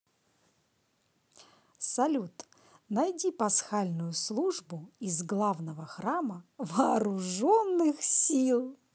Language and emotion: Russian, positive